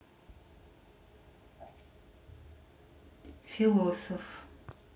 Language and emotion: Russian, neutral